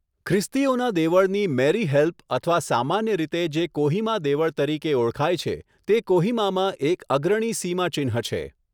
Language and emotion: Gujarati, neutral